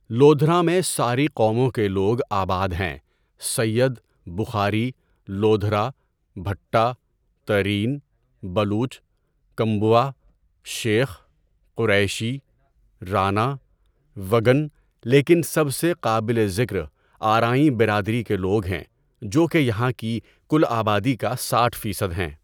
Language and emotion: Urdu, neutral